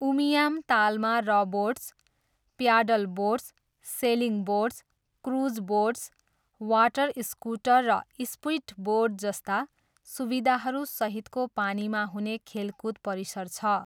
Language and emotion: Nepali, neutral